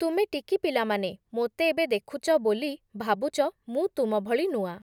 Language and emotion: Odia, neutral